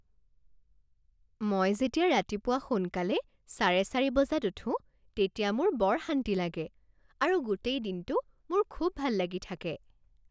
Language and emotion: Assamese, happy